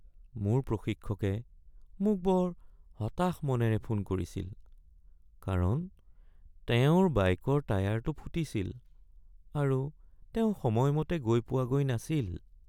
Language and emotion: Assamese, sad